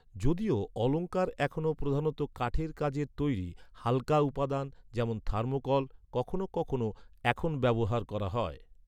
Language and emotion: Bengali, neutral